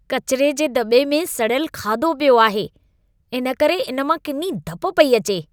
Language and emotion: Sindhi, disgusted